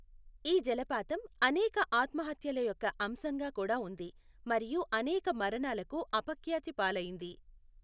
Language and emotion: Telugu, neutral